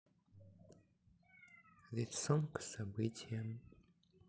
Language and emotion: Russian, sad